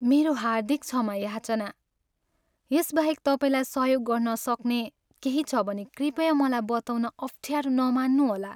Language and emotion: Nepali, sad